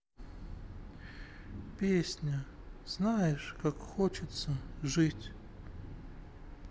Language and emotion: Russian, sad